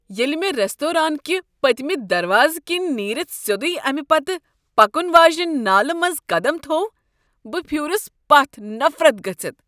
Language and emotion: Kashmiri, disgusted